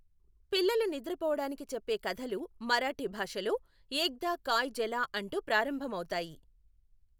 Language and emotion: Telugu, neutral